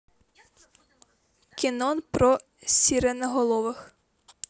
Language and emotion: Russian, neutral